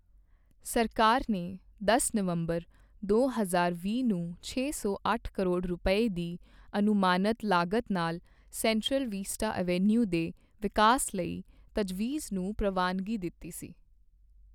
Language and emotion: Punjabi, neutral